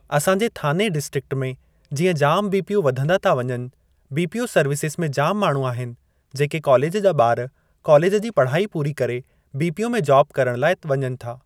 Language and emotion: Sindhi, neutral